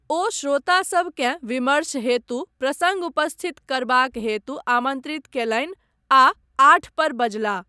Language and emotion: Maithili, neutral